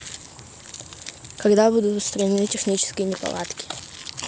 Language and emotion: Russian, neutral